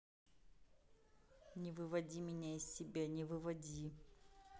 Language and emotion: Russian, angry